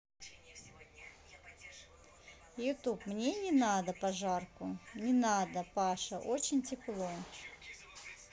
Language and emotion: Russian, neutral